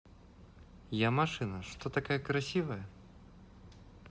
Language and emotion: Russian, positive